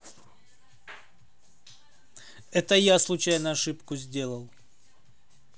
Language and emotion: Russian, neutral